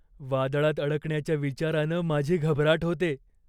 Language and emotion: Marathi, fearful